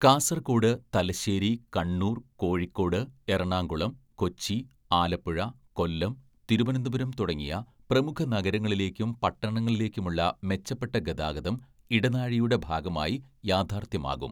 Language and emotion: Malayalam, neutral